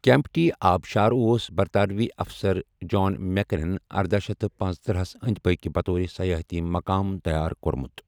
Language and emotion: Kashmiri, neutral